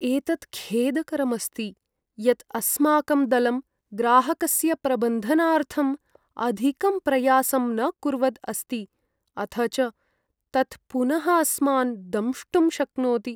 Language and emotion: Sanskrit, sad